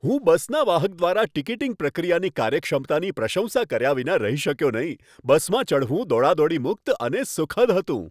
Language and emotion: Gujarati, happy